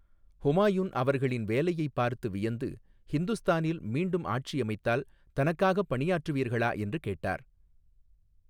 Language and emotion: Tamil, neutral